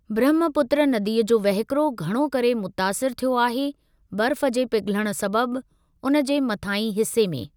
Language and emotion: Sindhi, neutral